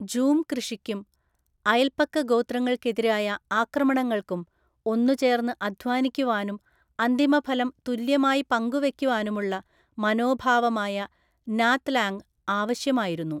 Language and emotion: Malayalam, neutral